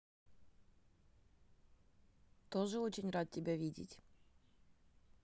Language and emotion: Russian, neutral